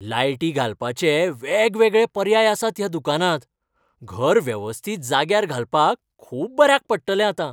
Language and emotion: Goan Konkani, happy